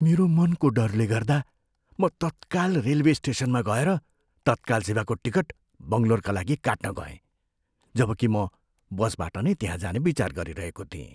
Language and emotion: Nepali, fearful